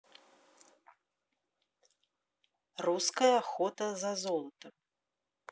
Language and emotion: Russian, neutral